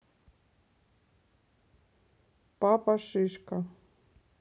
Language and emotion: Russian, neutral